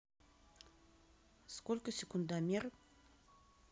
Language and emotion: Russian, neutral